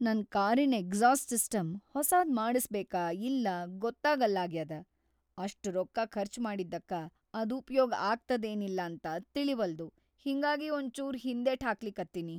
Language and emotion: Kannada, fearful